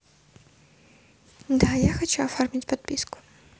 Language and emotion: Russian, neutral